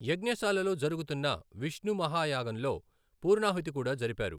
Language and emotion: Telugu, neutral